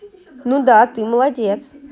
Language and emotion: Russian, positive